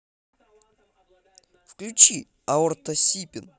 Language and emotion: Russian, positive